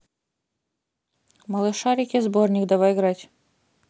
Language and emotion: Russian, neutral